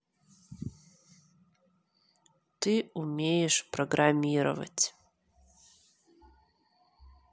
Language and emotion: Russian, neutral